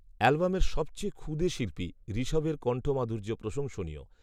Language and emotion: Bengali, neutral